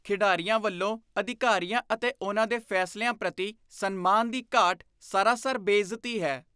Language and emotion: Punjabi, disgusted